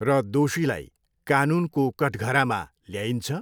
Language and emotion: Nepali, neutral